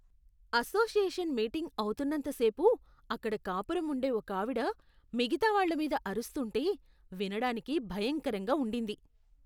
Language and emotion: Telugu, disgusted